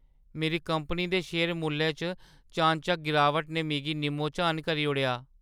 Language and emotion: Dogri, sad